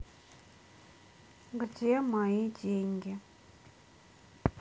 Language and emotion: Russian, sad